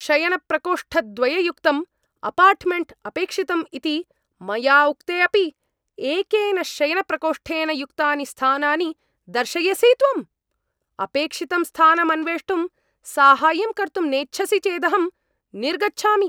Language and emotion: Sanskrit, angry